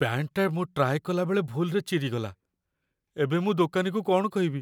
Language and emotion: Odia, fearful